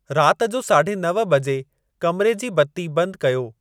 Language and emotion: Sindhi, neutral